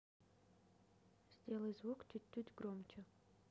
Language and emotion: Russian, neutral